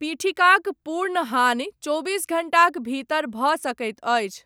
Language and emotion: Maithili, neutral